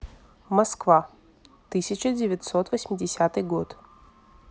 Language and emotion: Russian, neutral